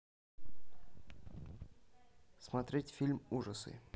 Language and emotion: Russian, neutral